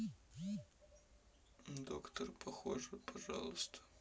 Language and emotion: Russian, sad